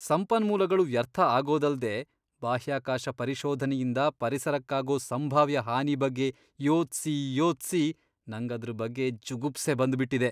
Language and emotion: Kannada, disgusted